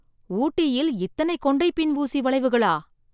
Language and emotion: Tamil, surprised